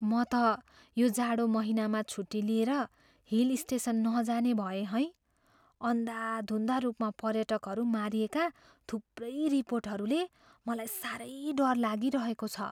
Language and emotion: Nepali, fearful